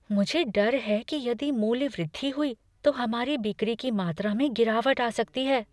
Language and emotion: Hindi, fearful